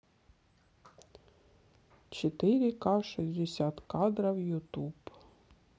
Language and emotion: Russian, neutral